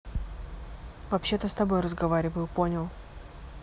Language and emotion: Russian, neutral